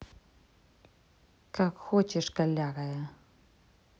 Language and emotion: Russian, angry